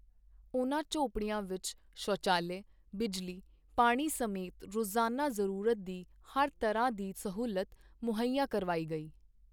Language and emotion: Punjabi, neutral